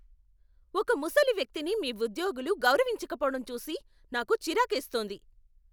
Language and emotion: Telugu, angry